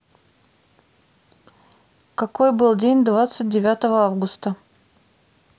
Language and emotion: Russian, neutral